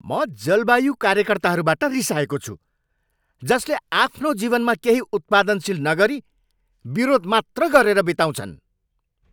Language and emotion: Nepali, angry